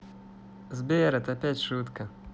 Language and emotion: Russian, positive